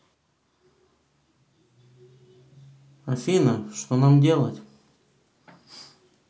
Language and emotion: Russian, neutral